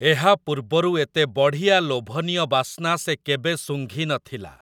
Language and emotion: Odia, neutral